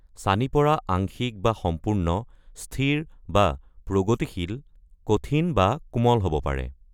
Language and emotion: Assamese, neutral